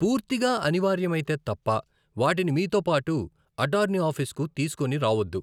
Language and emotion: Telugu, neutral